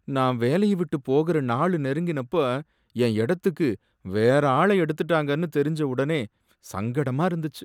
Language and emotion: Tamil, sad